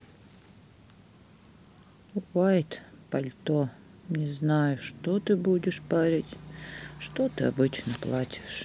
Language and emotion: Russian, sad